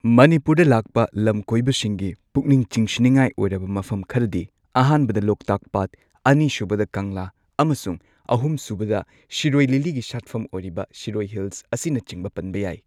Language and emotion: Manipuri, neutral